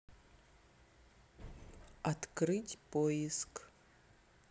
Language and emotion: Russian, neutral